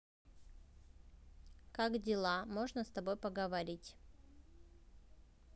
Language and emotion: Russian, neutral